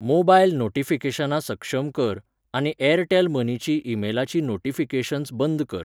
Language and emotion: Goan Konkani, neutral